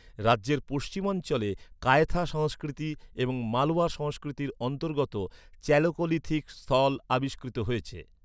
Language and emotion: Bengali, neutral